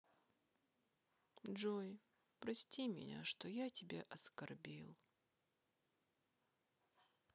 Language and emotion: Russian, sad